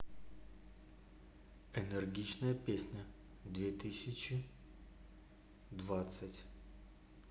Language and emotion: Russian, neutral